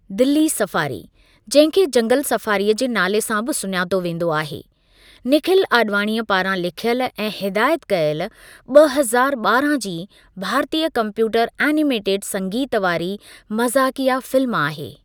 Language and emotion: Sindhi, neutral